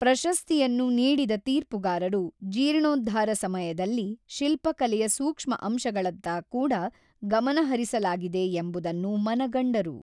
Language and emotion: Kannada, neutral